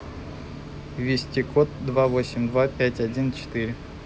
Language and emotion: Russian, neutral